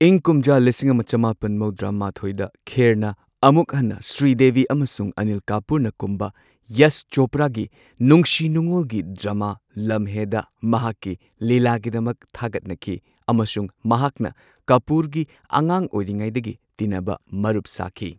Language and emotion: Manipuri, neutral